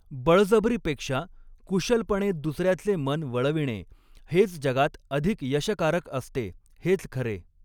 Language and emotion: Marathi, neutral